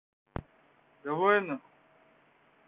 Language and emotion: Russian, neutral